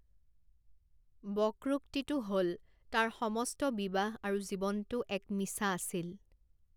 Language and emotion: Assamese, neutral